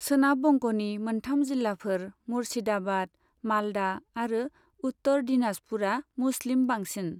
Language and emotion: Bodo, neutral